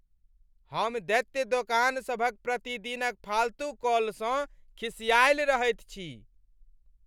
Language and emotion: Maithili, angry